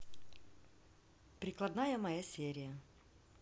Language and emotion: Russian, neutral